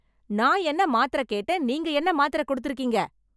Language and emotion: Tamil, angry